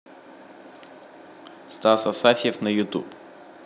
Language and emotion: Russian, neutral